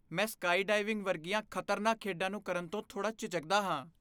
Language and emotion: Punjabi, fearful